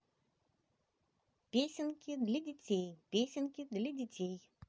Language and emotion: Russian, positive